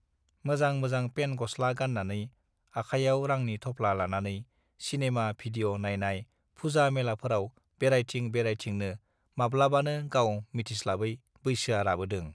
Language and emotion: Bodo, neutral